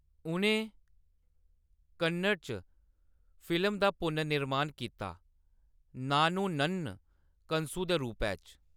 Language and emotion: Dogri, neutral